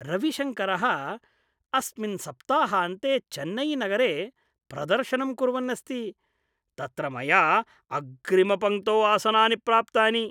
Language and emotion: Sanskrit, happy